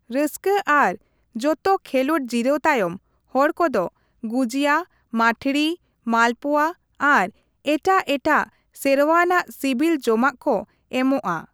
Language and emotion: Santali, neutral